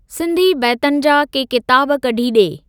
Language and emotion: Sindhi, neutral